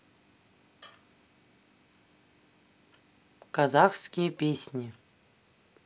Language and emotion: Russian, neutral